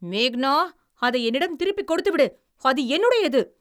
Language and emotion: Tamil, angry